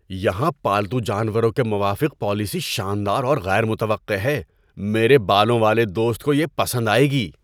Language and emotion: Urdu, surprised